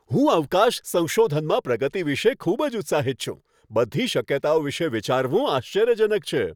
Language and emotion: Gujarati, happy